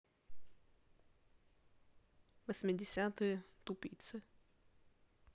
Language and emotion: Russian, neutral